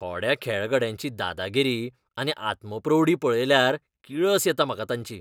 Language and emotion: Goan Konkani, disgusted